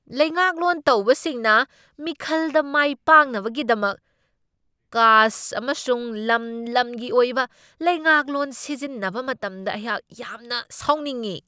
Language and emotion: Manipuri, angry